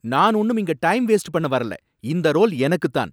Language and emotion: Tamil, angry